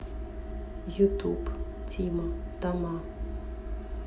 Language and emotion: Russian, neutral